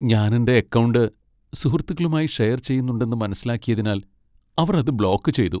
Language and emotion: Malayalam, sad